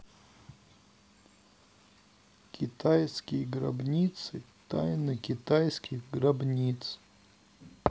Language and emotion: Russian, neutral